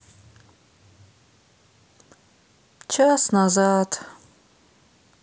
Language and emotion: Russian, sad